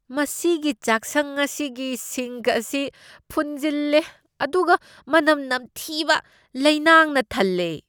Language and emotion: Manipuri, disgusted